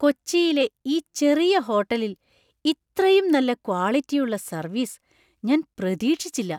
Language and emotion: Malayalam, surprised